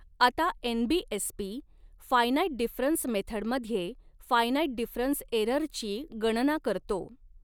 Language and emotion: Marathi, neutral